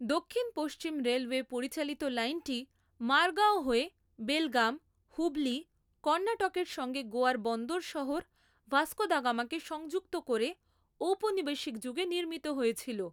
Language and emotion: Bengali, neutral